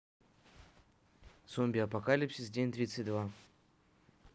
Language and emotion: Russian, neutral